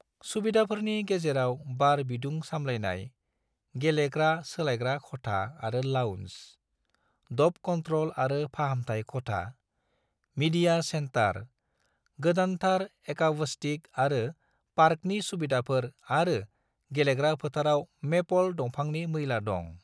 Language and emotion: Bodo, neutral